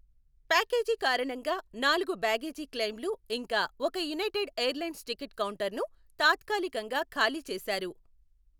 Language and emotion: Telugu, neutral